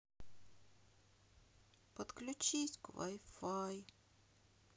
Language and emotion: Russian, sad